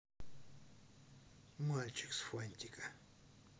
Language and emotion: Russian, neutral